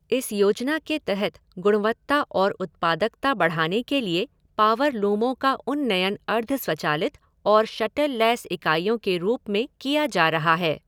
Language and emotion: Hindi, neutral